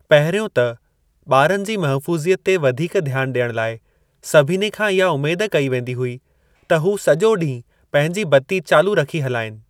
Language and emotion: Sindhi, neutral